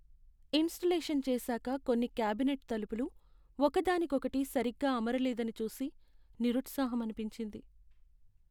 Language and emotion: Telugu, sad